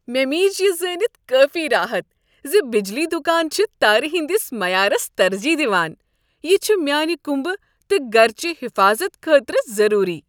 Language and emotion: Kashmiri, happy